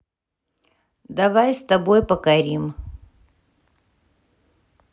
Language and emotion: Russian, neutral